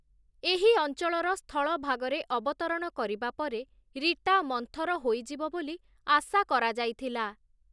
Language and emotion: Odia, neutral